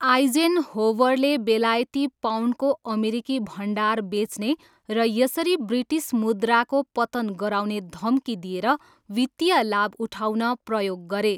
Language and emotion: Nepali, neutral